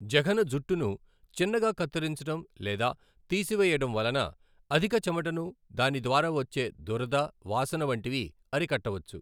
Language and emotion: Telugu, neutral